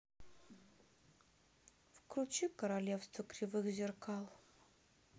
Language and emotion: Russian, sad